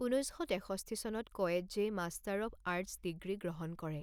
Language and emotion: Assamese, neutral